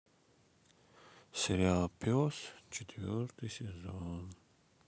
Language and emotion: Russian, sad